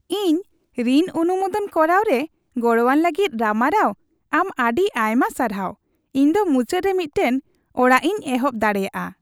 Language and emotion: Santali, happy